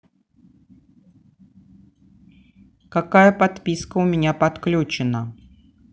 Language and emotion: Russian, neutral